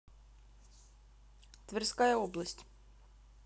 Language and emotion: Russian, neutral